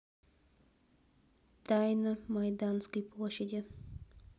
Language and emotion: Russian, neutral